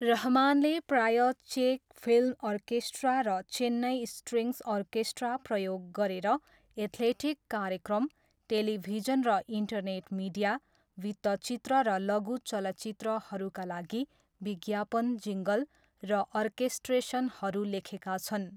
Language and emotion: Nepali, neutral